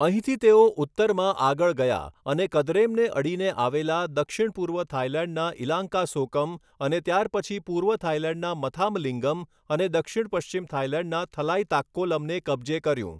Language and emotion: Gujarati, neutral